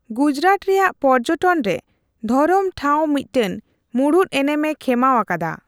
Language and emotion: Santali, neutral